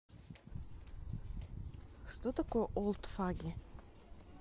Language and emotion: Russian, neutral